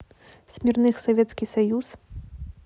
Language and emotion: Russian, neutral